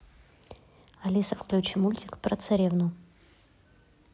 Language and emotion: Russian, neutral